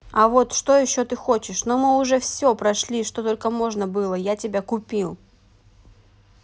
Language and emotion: Russian, neutral